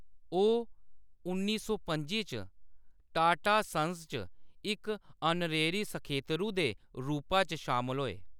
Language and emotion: Dogri, neutral